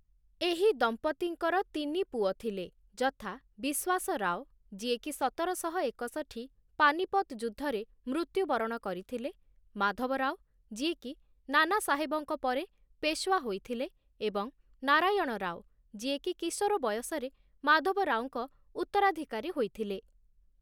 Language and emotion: Odia, neutral